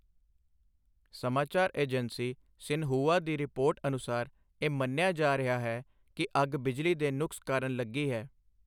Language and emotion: Punjabi, neutral